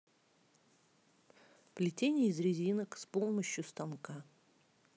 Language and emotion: Russian, neutral